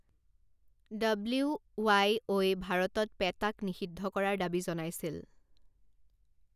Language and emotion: Assamese, neutral